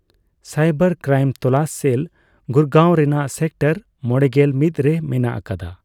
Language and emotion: Santali, neutral